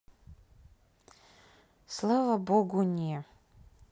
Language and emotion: Russian, neutral